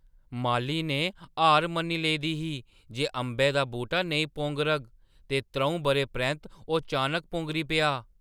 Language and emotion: Dogri, surprised